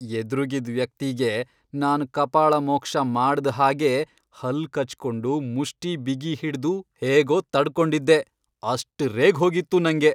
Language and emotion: Kannada, angry